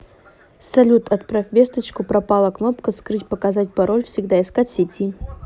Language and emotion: Russian, neutral